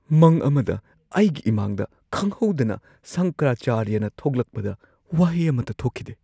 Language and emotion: Manipuri, surprised